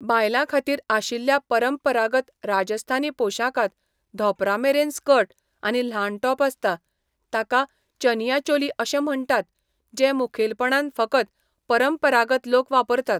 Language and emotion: Goan Konkani, neutral